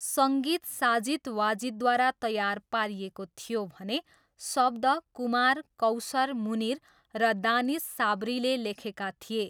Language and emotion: Nepali, neutral